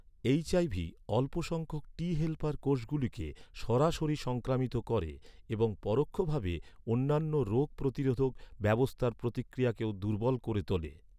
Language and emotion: Bengali, neutral